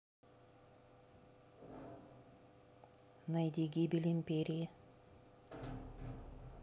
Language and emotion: Russian, neutral